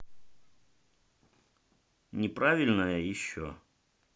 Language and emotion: Russian, neutral